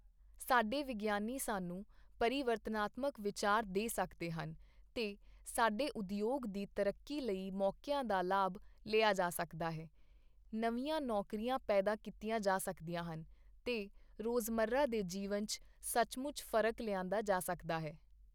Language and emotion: Punjabi, neutral